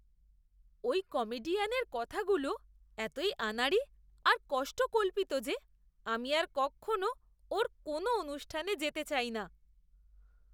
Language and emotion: Bengali, disgusted